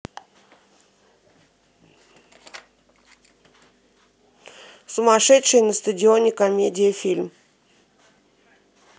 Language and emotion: Russian, neutral